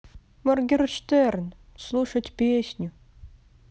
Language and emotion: Russian, sad